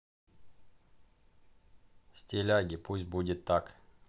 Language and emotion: Russian, neutral